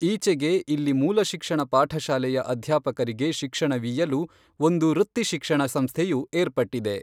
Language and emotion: Kannada, neutral